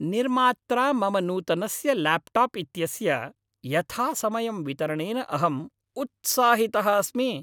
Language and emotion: Sanskrit, happy